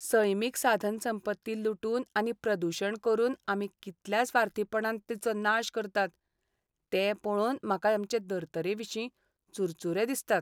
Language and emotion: Goan Konkani, sad